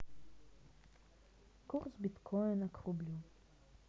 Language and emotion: Russian, sad